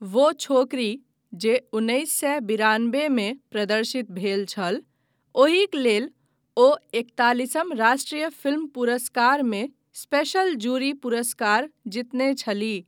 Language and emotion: Maithili, neutral